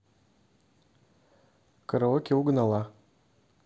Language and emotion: Russian, neutral